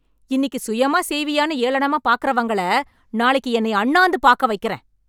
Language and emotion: Tamil, angry